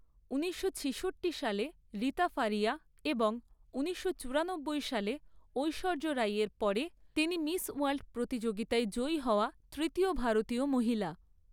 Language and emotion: Bengali, neutral